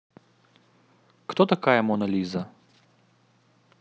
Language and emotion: Russian, neutral